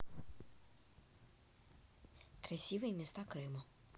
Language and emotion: Russian, neutral